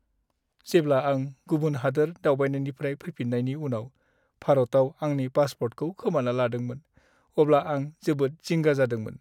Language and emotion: Bodo, sad